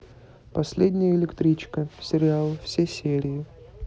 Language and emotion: Russian, neutral